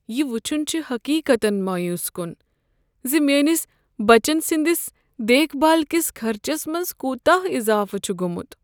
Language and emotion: Kashmiri, sad